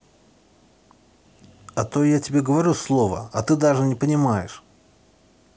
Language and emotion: Russian, angry